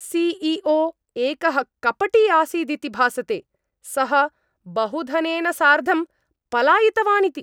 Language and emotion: Sanskrit, angry